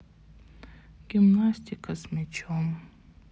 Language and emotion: Russian, sad